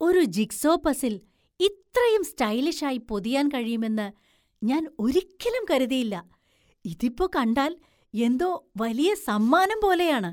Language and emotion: Malayalam, surprised